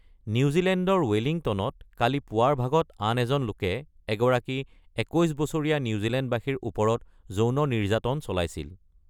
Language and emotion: Assamese, neutral